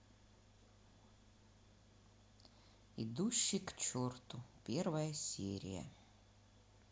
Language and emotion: Russian, neutral